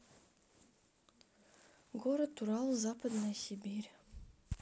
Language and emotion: Russian, neutral